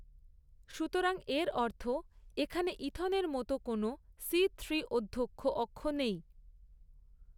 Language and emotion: Bengali, neutral